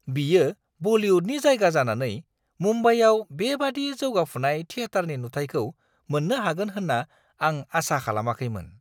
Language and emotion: Bodo, surprised